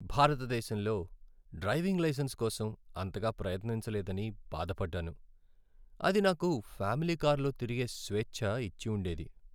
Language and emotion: Telugu, sad